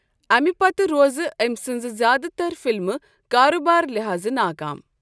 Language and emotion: Kashmiri, neutral